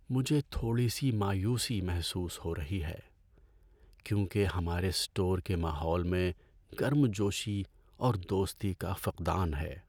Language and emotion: Urdu, sad